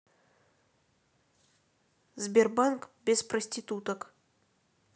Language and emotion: Russian, neutral